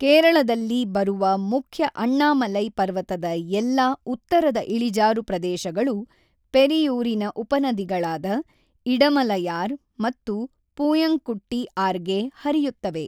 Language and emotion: Kannada, neutral